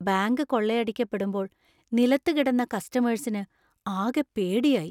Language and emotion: Malayalam, fearful